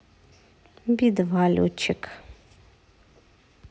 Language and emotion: Russian, neutral